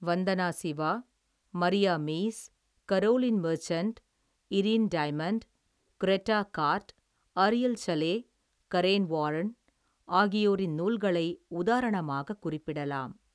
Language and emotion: Tamil, neutral